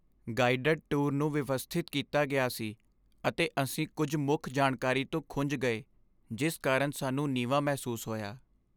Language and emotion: Punjabi, sad